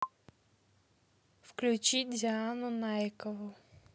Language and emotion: Russian, neutral